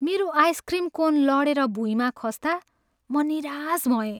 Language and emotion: Nepali, sad